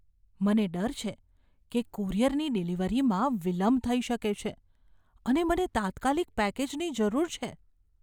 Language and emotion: Gujarati, fearful